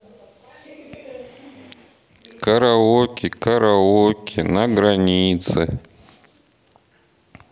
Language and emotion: Russian, neutral